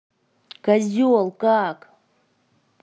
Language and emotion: Russian, angry